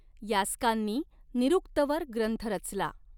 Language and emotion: Marathi, neutral